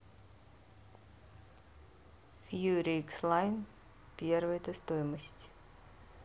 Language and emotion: Russian, neutral